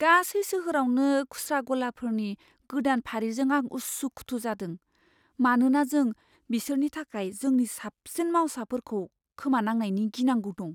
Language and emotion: Bodo, fearful